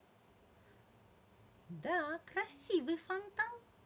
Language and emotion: Russian, positive